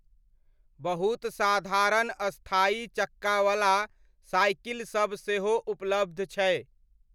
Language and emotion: Maithili, neutral